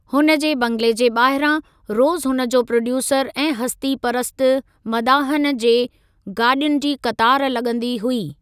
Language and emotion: Sindhi, neutral